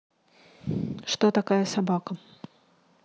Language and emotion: Russian, neutral